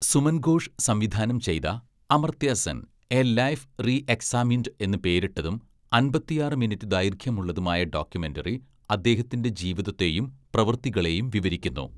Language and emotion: Malayalam, neutral